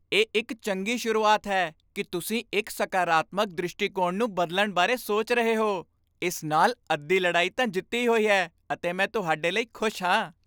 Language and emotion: Punjabi, happy